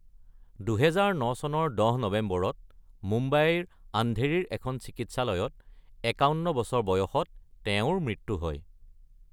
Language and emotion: Assamese, neutral